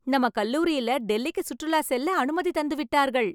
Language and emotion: Tamil, happy